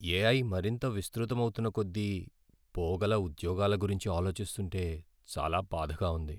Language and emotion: Telugu, sad